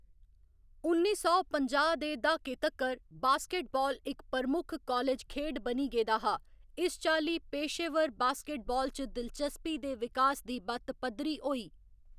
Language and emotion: Dogri, neutral